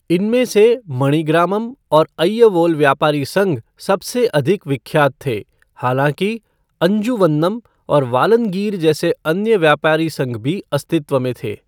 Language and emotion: Hindi, neutral